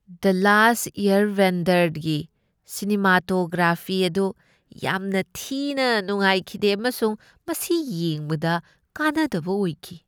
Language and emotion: Manipuri, disgusted